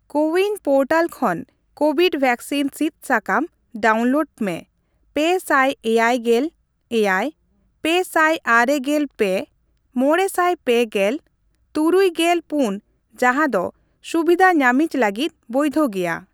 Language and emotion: Santali, neutral